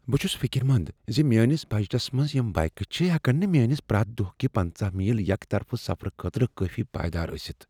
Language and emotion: Kashmiri, fearful